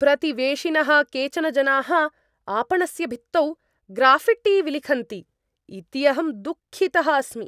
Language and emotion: Sanskrit, angry